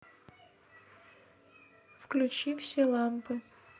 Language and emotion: Russian, neutral